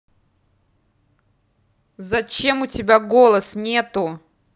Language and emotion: Russian, angry